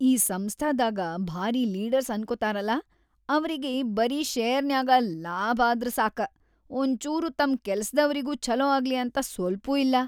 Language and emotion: Kannada, disgusted